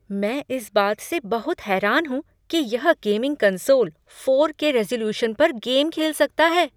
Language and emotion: Hindi, surprised